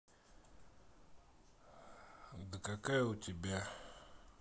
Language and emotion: Russian, neutral